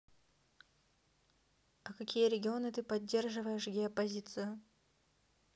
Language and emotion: Russian, neutral